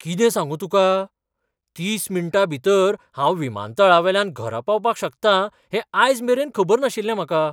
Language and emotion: Goan Konkani, surprised